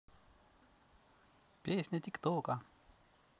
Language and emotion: Russian, positive